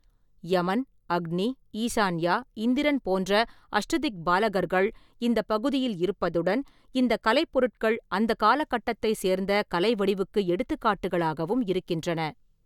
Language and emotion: Tamil, neutral